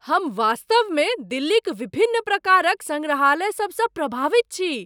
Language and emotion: Maithili, surprised